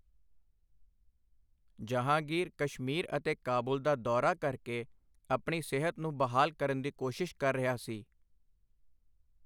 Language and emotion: Punjabi, neutral